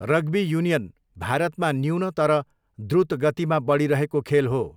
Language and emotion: Nepali, neutral